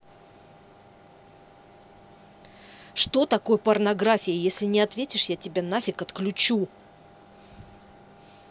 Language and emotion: Russian, angry